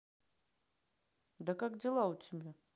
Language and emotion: Russian, neutral